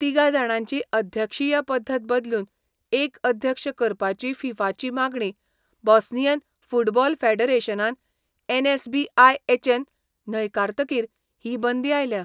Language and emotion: Goan Konkani, neutral